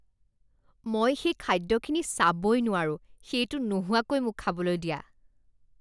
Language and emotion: Assamese, disgusted